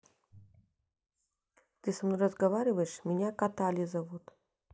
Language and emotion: Russian, neutral